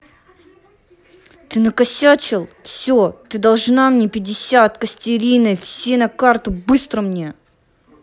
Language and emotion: Russian, angry